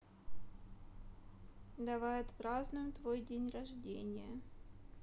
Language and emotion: Russian, neutral